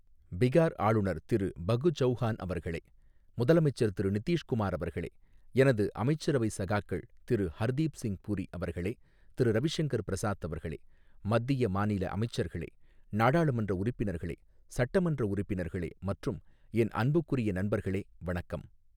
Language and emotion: Tamil, neutral